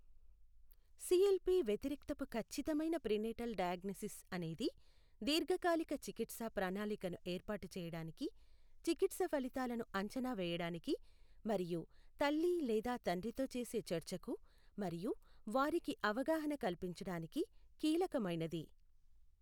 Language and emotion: Telugu, neutral